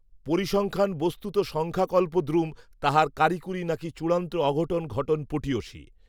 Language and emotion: Bengali, neutral